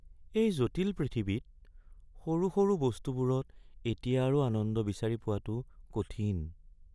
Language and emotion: Assamese, sad